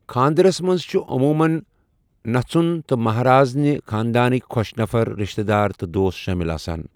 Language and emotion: Kashmiri, neutral